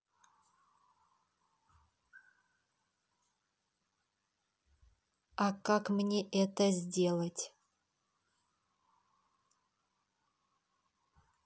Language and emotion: Russian, neutral